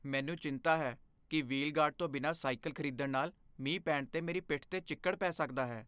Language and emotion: Punjabi, fearful